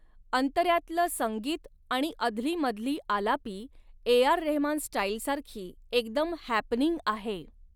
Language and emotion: Marathi, neutral